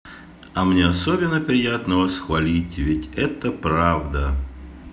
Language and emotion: Russian, positive